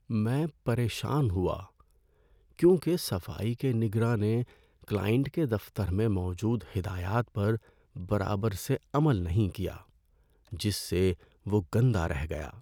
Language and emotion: Urdu, sad